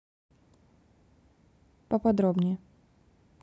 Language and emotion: Russian, neutral